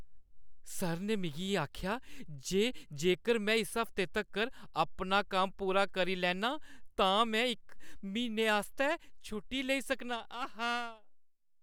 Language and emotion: Dogri, happy